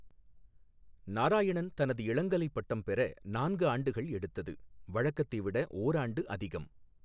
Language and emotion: Tamil, neutral